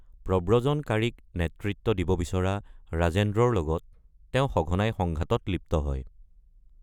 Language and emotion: Assamese, neutral